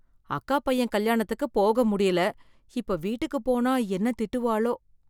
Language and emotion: Tamil, fearful